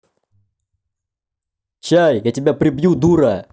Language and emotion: Russian, angry